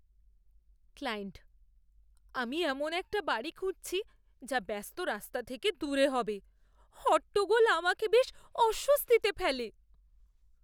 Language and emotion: Bengali, fearful